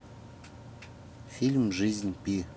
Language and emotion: Russian, neutral